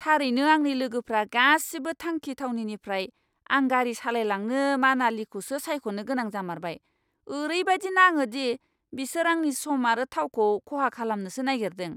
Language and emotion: Bodo, angry